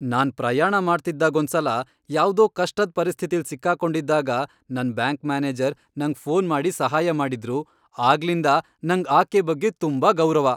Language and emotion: Kannada, happy